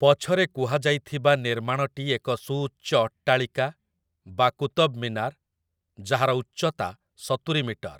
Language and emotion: Odia, neutral